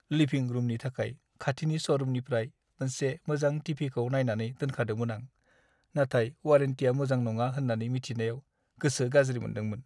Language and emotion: Bodo, sad